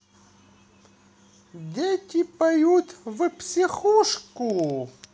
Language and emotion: Russian, positive